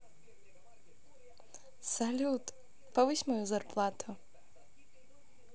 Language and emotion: Russian, positive